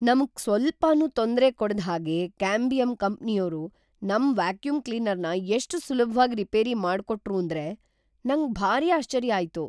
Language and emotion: Kannada, surprised